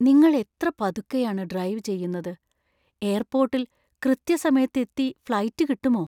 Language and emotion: Malayalam, fearful